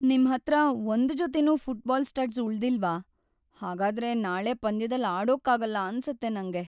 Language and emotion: Kannada, sad